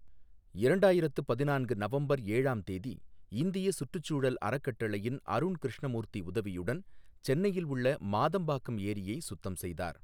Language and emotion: Tamil, neutral